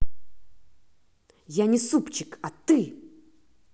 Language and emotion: Russian, angry